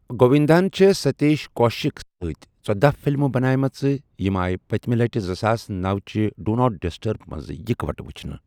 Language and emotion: Kashmiri, neutral